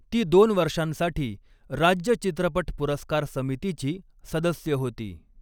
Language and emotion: Marathi, neutral